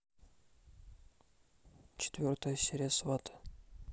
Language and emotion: Russian, neutral